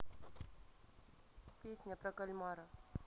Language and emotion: Russian, neutral